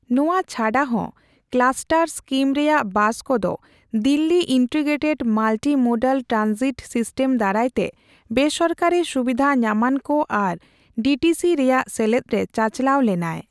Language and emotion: Santali, neutral